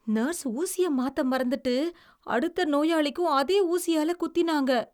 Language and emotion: Tamil, disgusted